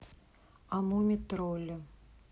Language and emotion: Russian, neutral